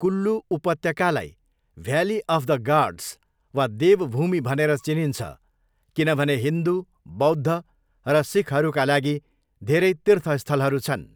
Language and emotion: Nepali, neutral